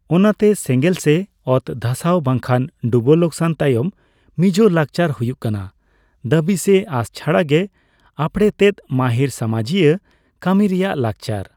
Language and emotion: Santali, neutral